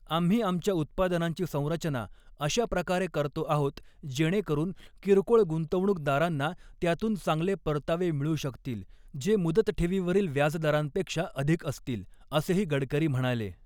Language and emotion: Marathi, neutral